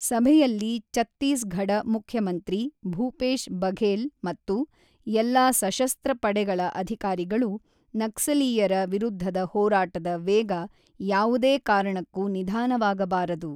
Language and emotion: Kannada, neutral